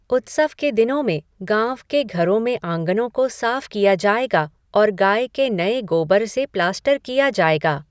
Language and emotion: Hindi, neutral